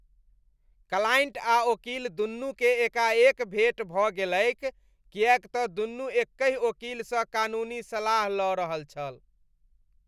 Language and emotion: Maithili, disgusted